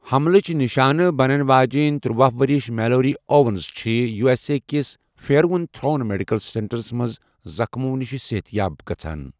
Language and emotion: Kashmiri, neutral